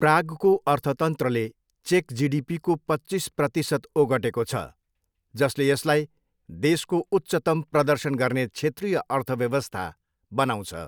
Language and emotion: Nepali, neutral